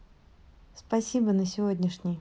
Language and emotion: Russian, neutral